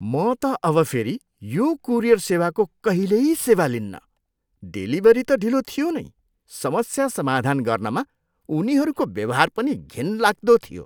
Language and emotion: Nepali, disgusted